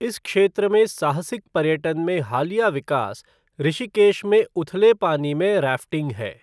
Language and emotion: Hindi, neutral